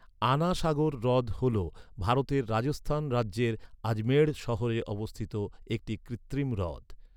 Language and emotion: Bengali, neutral